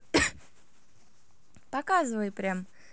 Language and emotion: Russian, positive